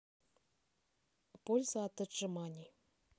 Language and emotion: Russian, neutral